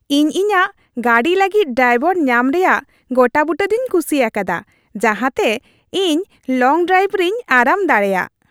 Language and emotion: Santali, happy